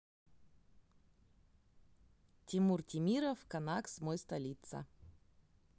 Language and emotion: Russian, neutral